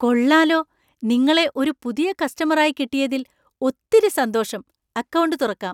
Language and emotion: Malayalam, surprised